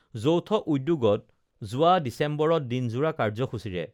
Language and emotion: Assamese, neutral